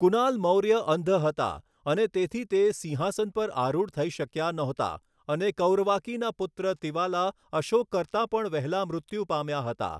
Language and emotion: Gujarati, neutral